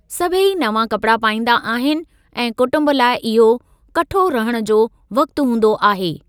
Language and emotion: Sindhi, neutral